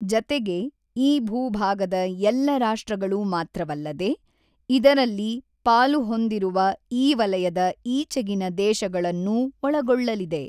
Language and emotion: Kannada, neutral